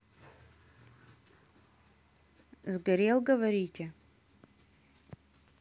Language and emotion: Russian, neutral